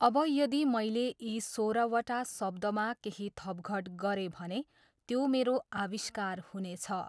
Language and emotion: Nepali, neutral